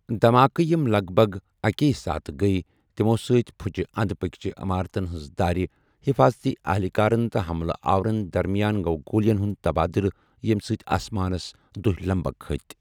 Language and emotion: Kashmiri, neutral